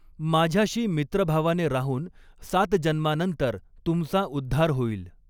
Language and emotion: Marathi, neutral